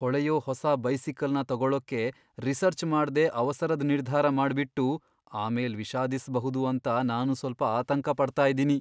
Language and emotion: Kannada, fearful